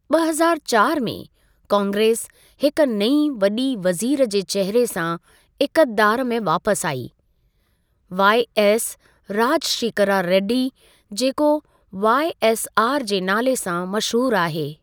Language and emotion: Sindhi, neutral